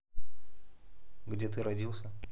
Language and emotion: Russian, neutral